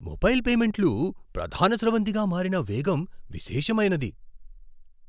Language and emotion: Telugu, surprised